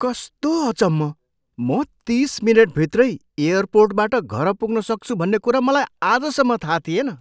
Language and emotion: Nepali, surprised